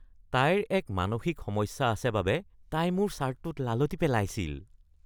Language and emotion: Assamese, disgusted